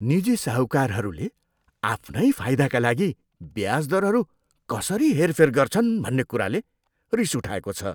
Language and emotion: Nepali, disgusted